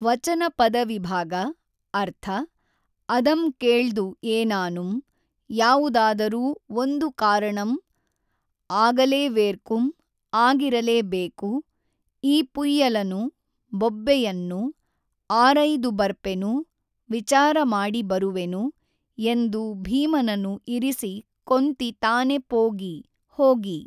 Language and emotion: Kannada, neutral